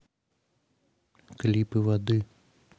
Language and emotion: Russian, neutral